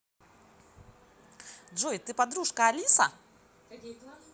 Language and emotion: Russian, neutral